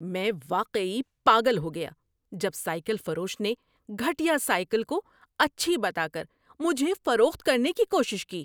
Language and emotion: Urdu, angry